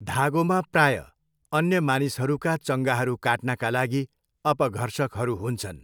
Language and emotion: Nepali, neutral